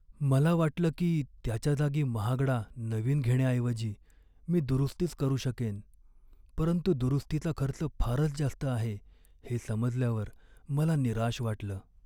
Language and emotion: Marathi, sad